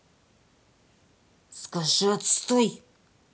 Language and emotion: Russian, angry